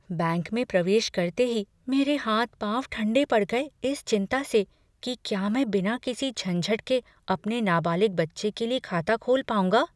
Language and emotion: Hindi, fearful